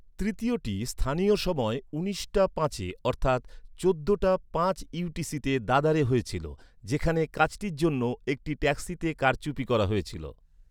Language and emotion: Bengali, neutral